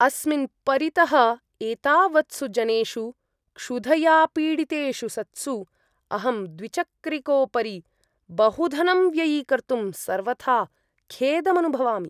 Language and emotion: Sanskrit, disgusted